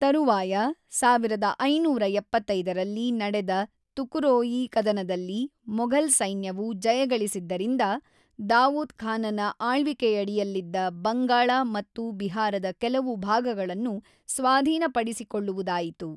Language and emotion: Kannada, neutral